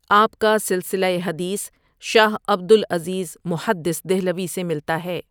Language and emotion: Urdu, neutral